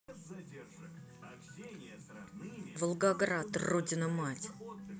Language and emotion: Russian, angry